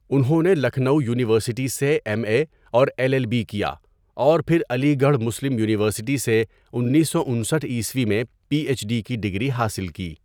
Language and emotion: Urdu, neutral